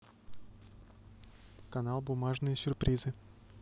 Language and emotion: Russian, neutral